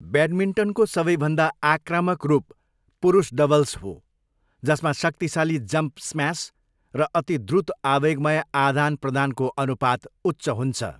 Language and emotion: Nepali, neutral